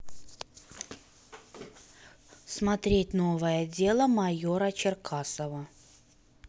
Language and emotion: Russian, neutral